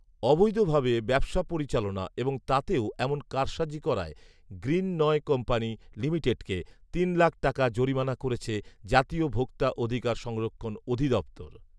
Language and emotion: Bengali, neutral